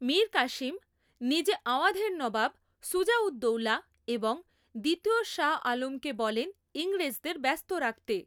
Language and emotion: Bengali, neutral